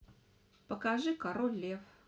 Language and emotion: Russian, neutral